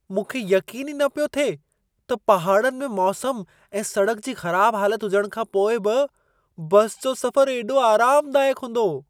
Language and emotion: Sindhi, surprised